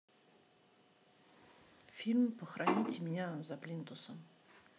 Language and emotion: Russian, neutral